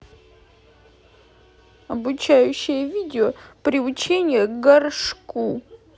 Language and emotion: Russian, sad